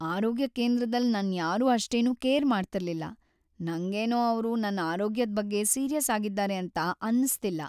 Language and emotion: Kannada, sad